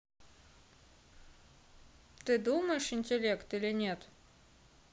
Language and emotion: Russian, neutral